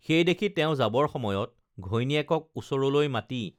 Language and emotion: Assamese, neutral